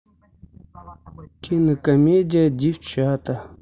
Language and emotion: Russian, neutral